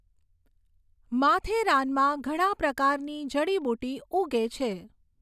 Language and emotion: Gujarati, neutral